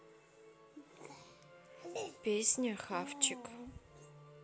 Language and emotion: Russian, neutral